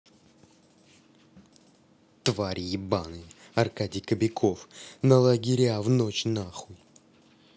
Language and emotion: Russian, angry